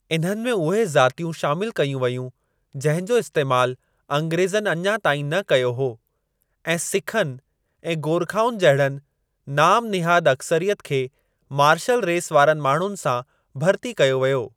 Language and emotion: Sindhi, neutral